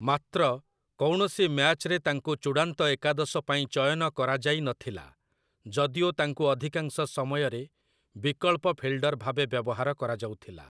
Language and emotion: Odia, neutral